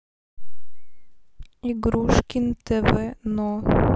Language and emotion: Russian, neutral